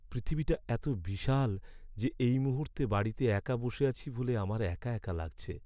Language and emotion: Bengali, sad